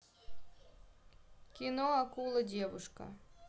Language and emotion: Russian, neutral